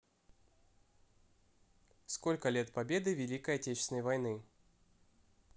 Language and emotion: Russian, neutral